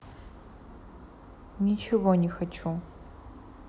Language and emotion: Russian, neutral